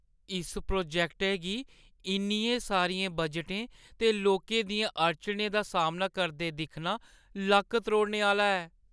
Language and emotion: Dogri, sad